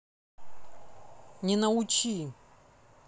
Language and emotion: Russian, neutral